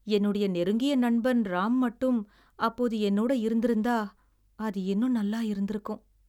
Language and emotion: Tamil, sad